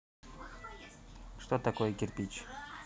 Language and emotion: Russian, neutral